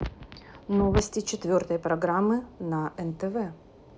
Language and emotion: Russian, neutral